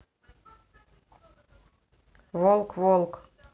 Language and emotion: Russian, neutral